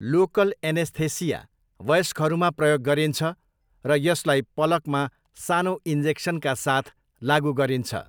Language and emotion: Nepali, neutral